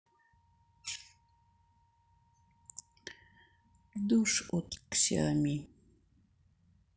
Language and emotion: Russian, sad